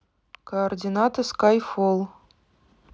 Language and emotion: Russian, neutral